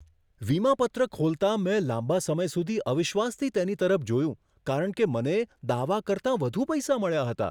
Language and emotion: Gujarati, surprised